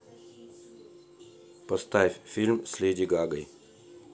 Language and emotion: Russian, neutral